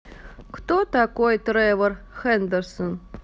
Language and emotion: Russian, neutral